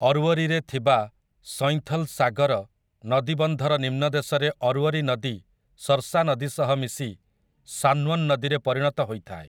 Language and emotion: Odia, neutral